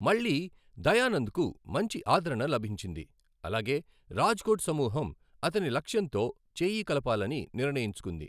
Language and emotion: Telugu, neutral